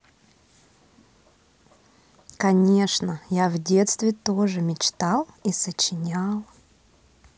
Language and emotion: Russian, positive